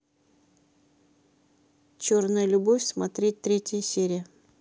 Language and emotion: Russian, neutral